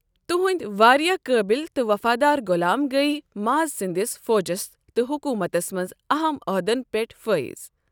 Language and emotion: Kashmiri, neutral